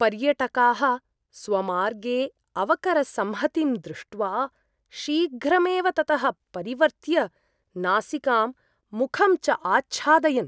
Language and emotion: Sanskrit, disgusted